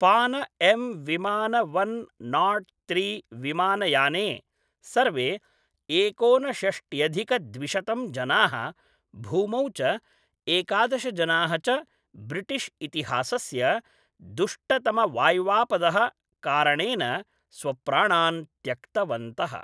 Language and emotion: Sanskrit, neutral